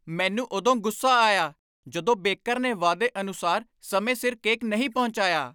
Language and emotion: Punjabi, angry